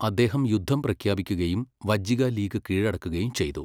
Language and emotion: Malayalam, neutral